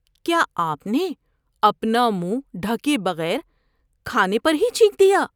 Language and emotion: Urdu, disgusted